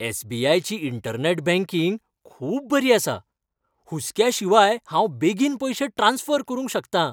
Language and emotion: Goan Konkani, happy